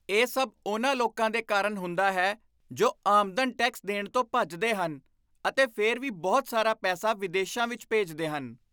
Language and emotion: Punjabi, disgusted